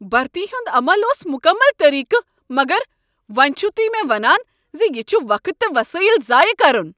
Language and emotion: Kashmiri, angry